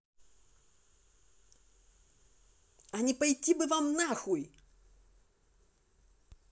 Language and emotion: Russian, angry